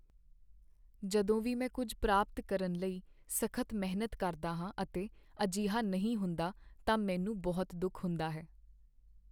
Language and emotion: Punjabi, sad